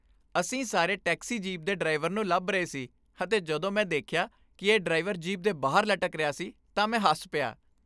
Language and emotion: Punjabi, happy